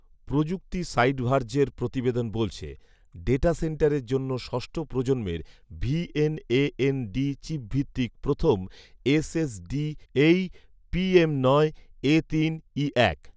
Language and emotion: Bengali, neutral